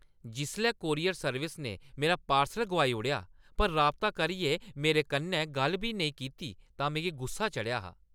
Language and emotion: Dogri, angry